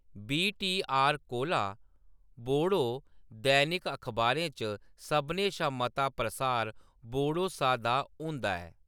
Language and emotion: Dogri, neutral